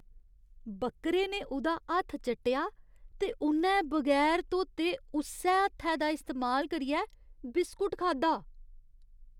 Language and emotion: Dogri, disgusted